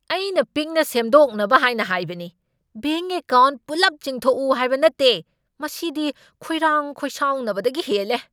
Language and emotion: Manipuri, angry